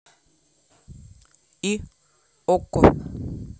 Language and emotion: Russian, neutral